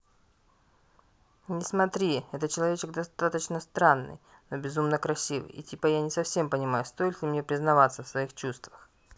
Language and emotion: Russian, neutral